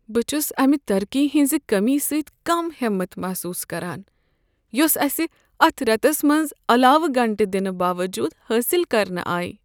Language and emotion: Kashmiri, sad